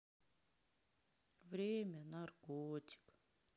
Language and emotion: Russian, sad